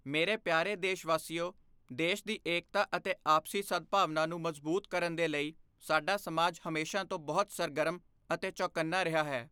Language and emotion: Punjabi, neutral